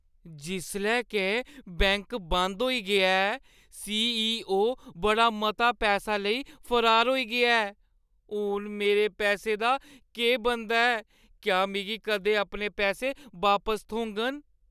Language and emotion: Dogri, fearful